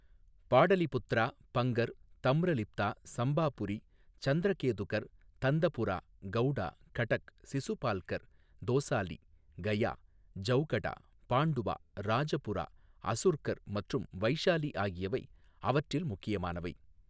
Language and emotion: Tamil, neutral